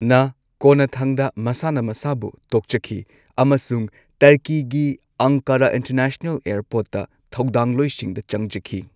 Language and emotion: Manipuri, neutral